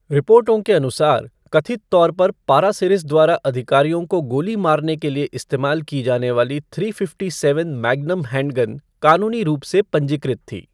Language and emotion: Hindi, neutral